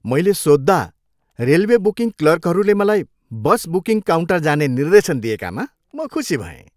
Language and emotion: Nepali, happy